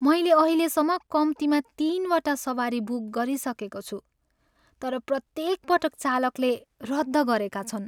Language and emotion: Nepali, sad